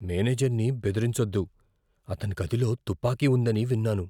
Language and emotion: Telugu, fearful